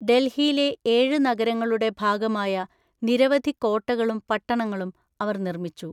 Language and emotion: Malayalam, neutral